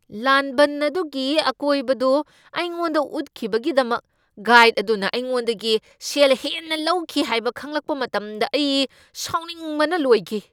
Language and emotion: Manipuri, angry